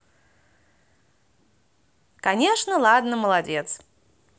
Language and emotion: Russian, positive